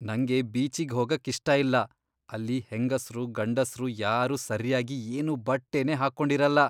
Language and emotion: Kannada, disgusted